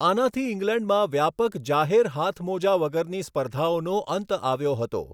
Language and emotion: Gujarati, neutral